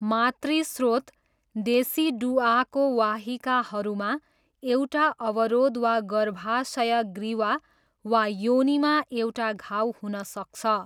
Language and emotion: Nepali, neutral